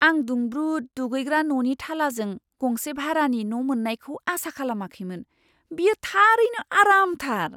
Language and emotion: Bodo, surprised